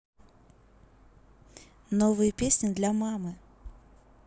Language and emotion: Russian, neutral